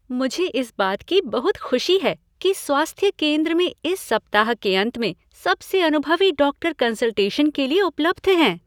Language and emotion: Hindi, happy